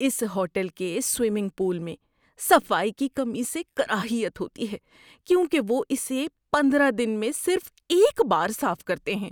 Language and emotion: Urdu, disgusted